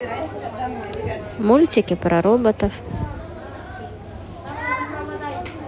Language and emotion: Russian, neutral